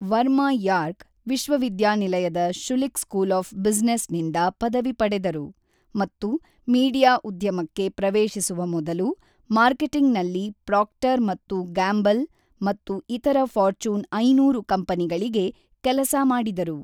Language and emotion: Kannada, neutral